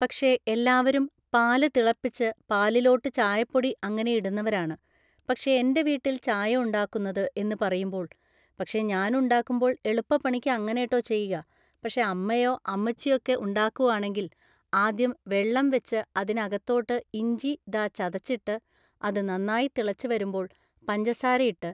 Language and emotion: Malayalam, neutral